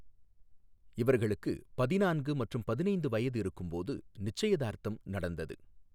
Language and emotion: Tamil, neutral